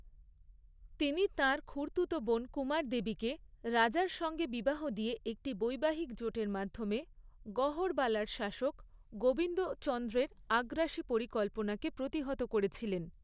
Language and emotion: Bengali, neutral